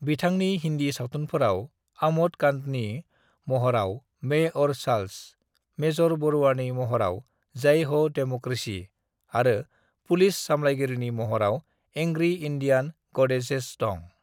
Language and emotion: Bodo, neutral